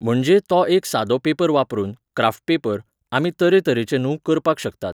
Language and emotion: Goan Konkani, neutral